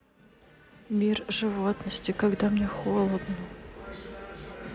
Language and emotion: Russian, sad